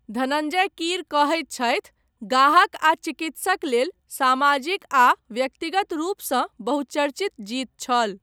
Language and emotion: Maithili, neutral